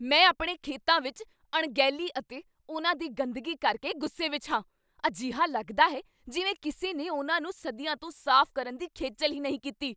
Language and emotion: Punjabi, angry